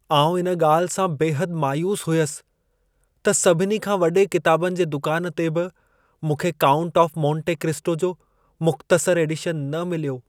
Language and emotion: Sindhi, sad